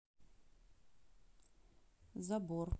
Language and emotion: Russian, neutral